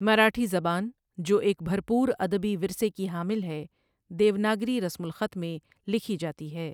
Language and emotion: Urdu, neutral